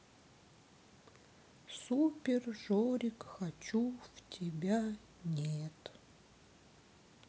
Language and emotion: Russian, sad